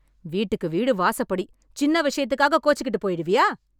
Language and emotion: Tamil, angry